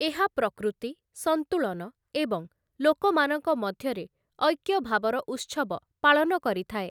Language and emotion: Odia, neutral